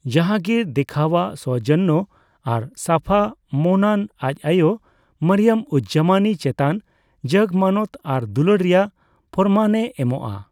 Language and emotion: Santali, neutral